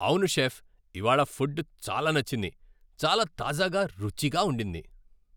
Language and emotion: Telugu, happy